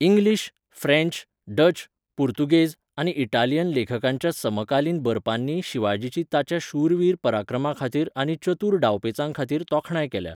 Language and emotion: Goan Konkani, neutral